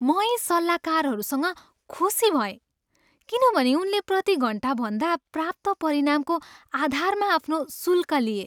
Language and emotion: Nepali, happy